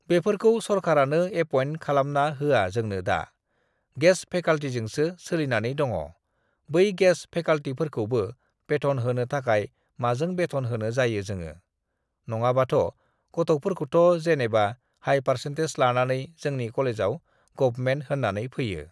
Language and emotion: Bodo, neutral